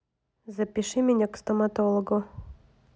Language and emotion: Russian, neutral